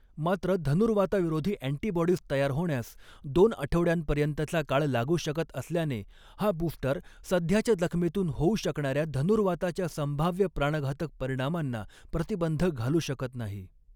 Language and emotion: Marathi, neutral